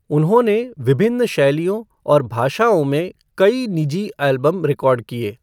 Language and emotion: Hindi, neutral